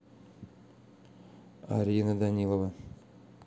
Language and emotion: Russian, neutral